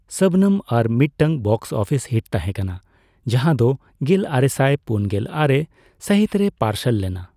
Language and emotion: Santali, neutral